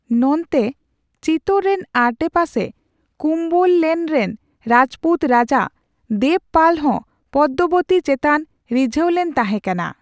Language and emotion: Santali, neutral